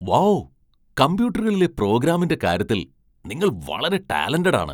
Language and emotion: Malayalam, surprised